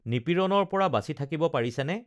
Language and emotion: Assamese, neutral